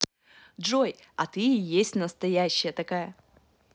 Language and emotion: Russian, positive